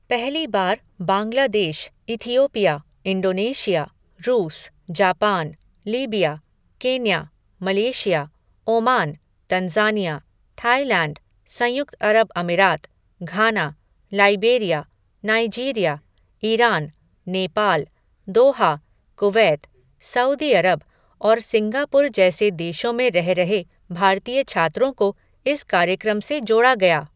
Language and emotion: Hindi, neutral